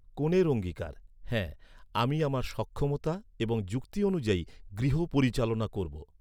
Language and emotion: Bengali, neutral